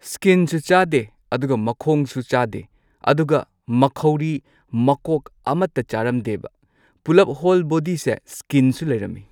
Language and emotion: Manipuri, neutral